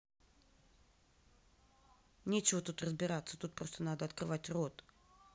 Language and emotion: Russian, neutral